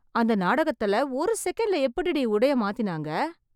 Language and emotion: Tamil, surprised